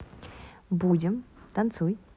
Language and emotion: Russian, neutral